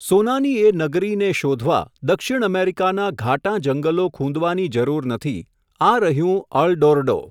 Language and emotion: Gujarati, neutral